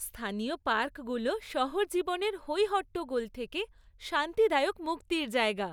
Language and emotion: Bengali, happy